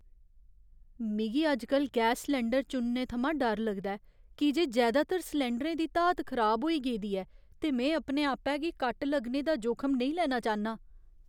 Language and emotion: Dogri, fearful